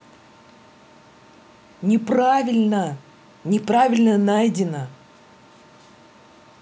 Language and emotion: Russian, angry